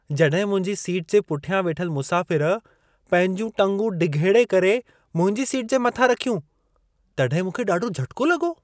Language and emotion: Sindhi, surprised